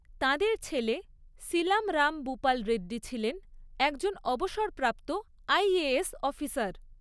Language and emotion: Bengali, neutral